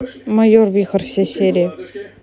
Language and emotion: Russian, neutral